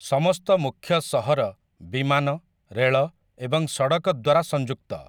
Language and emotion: Odia, neutral